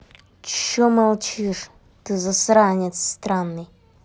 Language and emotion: Russian, angry